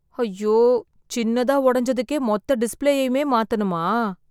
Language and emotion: Tamil, sad